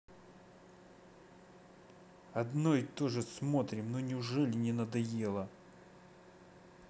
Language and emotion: Russian, angry